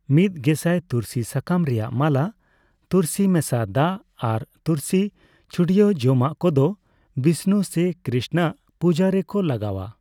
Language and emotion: Santali, neutral